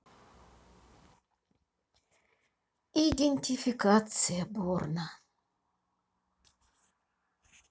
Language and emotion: Russian, sad